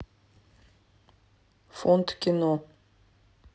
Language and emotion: Russian, neutral